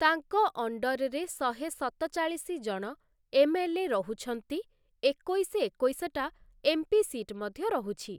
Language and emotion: Odia, neutral